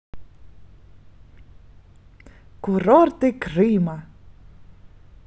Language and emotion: Russian, positive